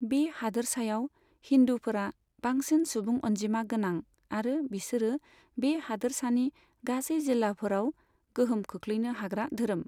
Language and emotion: Bodo, neutral